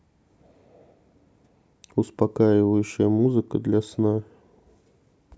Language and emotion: Russian, neutral